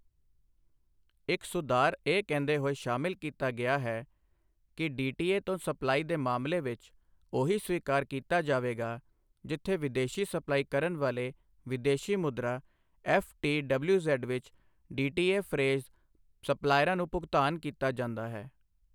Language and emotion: Punjabi, neutral